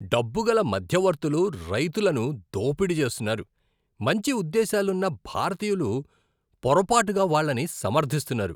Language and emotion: Telugu, disgusted